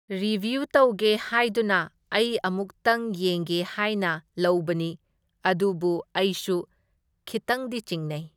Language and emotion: Manipuri, neutral